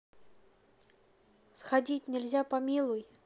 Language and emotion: Russian, neutral